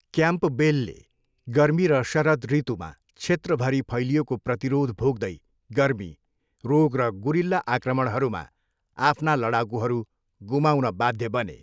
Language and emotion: Nepali, neutral